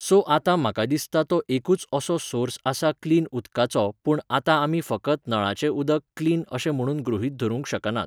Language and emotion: Goan Konkani, neutral